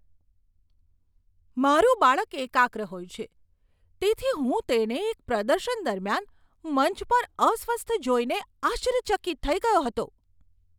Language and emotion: Gujarati, surprised